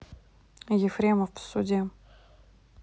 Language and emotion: Russian, neutral